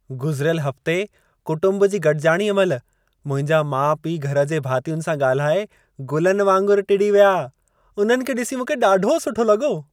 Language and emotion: Sindhi, happy